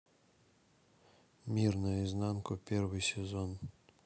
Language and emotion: Russian, neutral